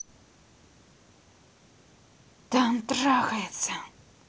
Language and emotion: Russian, angry